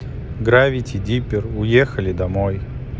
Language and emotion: Russian, neutral